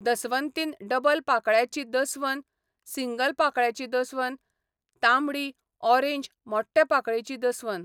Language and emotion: Goan Konkani, neutral